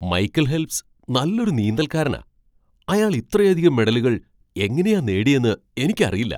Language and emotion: Malayalam, surprised